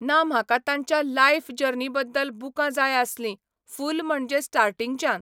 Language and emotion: Goan Konkani, neutral